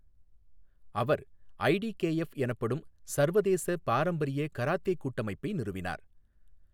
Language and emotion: Tamil, neutral